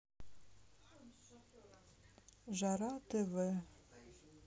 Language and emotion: Russian, sad